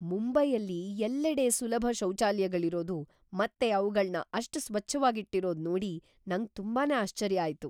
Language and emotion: Kannada, surprised